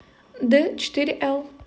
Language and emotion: Russian, neutral